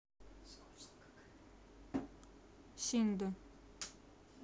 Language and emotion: Russian, neutral